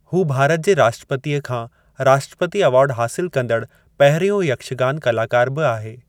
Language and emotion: Sindhi, neutral